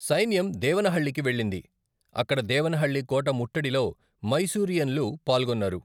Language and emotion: Telugu, neutral